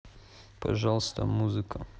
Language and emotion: Russian, neutral